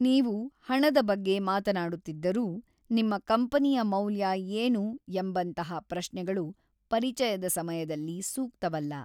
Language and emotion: Kannada, neutral